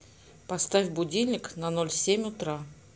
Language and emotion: Russian, neutral